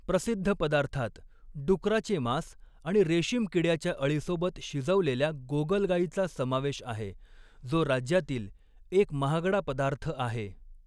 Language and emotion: Marathi, neutral